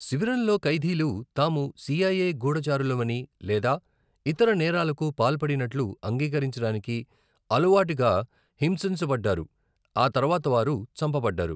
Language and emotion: Telugu, neutral